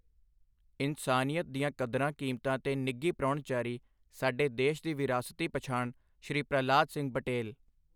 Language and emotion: Punjabi, neutral